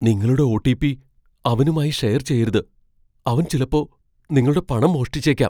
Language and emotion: Malayalam, fearful